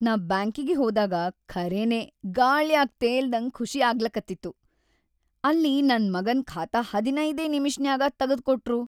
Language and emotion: Kannada, happy